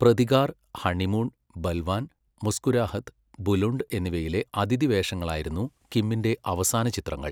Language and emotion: Malayalam, neutral